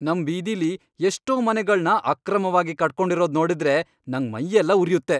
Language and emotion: Kannada, angry